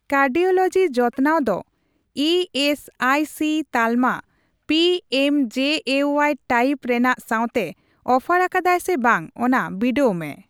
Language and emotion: Santali, neutral